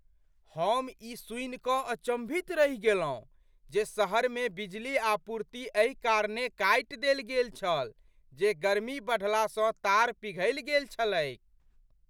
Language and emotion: Maithili, surprised